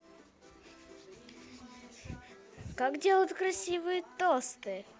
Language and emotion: Russian, positive